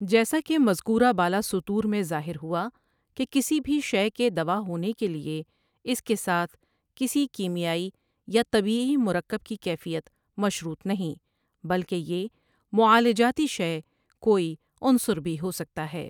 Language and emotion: Urdu, neutral